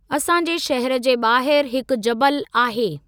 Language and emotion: Sindhi, neutral